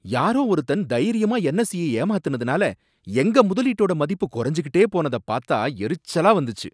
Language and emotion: Tamil, angry